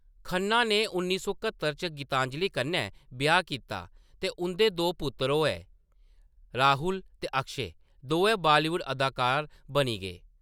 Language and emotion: Dogri, neutral